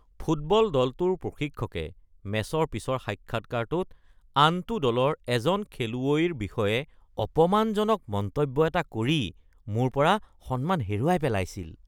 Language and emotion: Assamese, disgusted